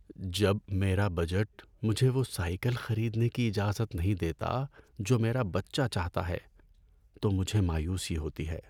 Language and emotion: Urdu, sad